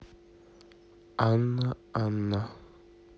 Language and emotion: Russian, neutral